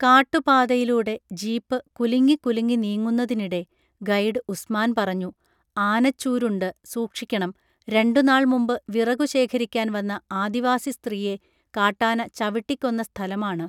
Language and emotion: Malayalam, neutral